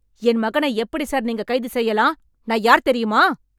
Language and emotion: Tamil, angry